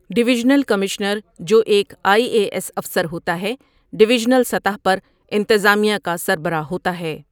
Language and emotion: Urdu, neutral